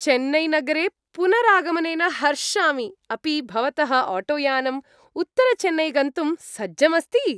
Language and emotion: Sanskrit, happy